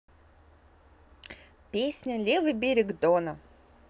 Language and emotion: Russian, positive